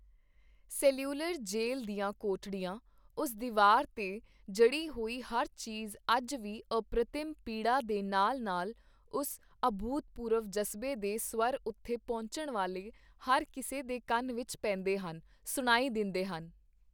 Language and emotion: Punjabi, neutral